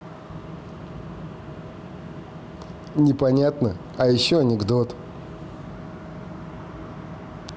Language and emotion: Russian, neutral